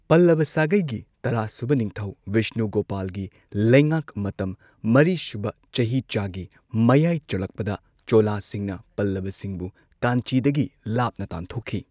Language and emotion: Manipuri, neutral